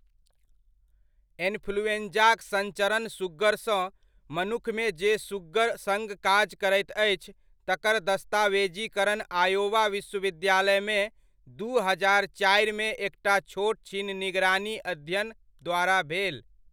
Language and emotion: Maithili, neutral